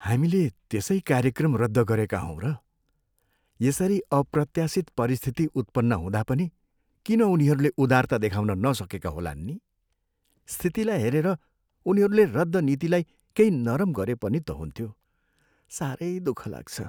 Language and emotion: Nepali, sad